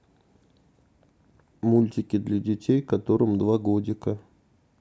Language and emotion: Russian, neutral